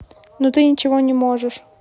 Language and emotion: Russian, angry